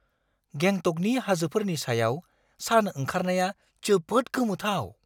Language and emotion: Bodo, surprised